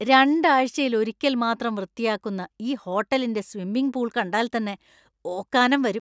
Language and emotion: Malayalam, disgusted